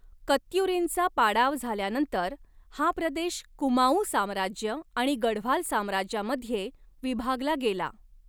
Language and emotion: Marathi, neutral